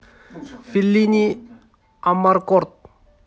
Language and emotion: Russian, neutral